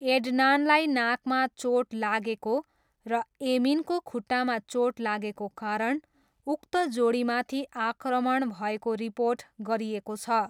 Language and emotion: Nepali, neutral